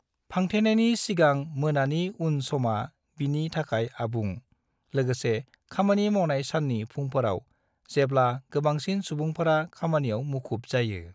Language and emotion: Bodo, neutral